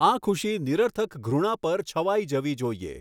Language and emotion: Gujarati, neutral